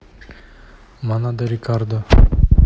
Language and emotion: Russian, neutral